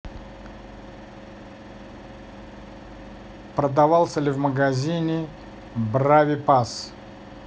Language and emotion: Russian, neutral